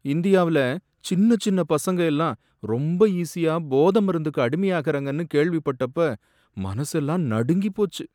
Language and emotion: Tamil, sad